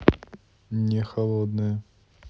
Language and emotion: Russian, neutral